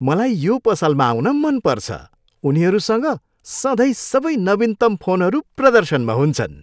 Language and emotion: Nepali, happy